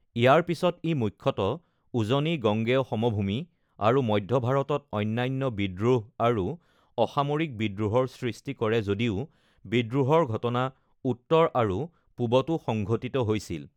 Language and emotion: Assamese, neutral